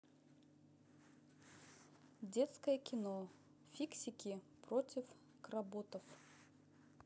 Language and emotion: Russian, neutral